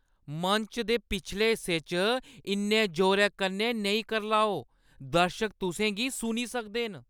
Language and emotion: Dogri, angry